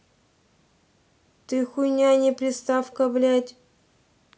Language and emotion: Russian, angry